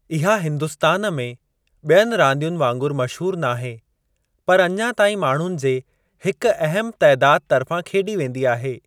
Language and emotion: Sindhi, neutral